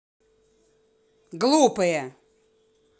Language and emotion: Russian, angry